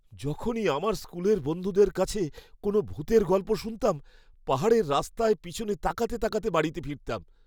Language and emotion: Bengali, fearful